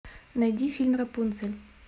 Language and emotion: Russian, neutral